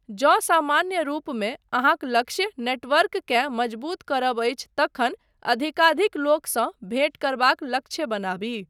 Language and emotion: Maithili, neutral